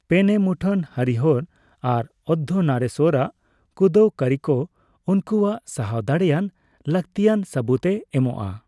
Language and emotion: Santali, neutral